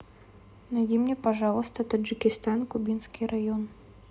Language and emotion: Russian, neutral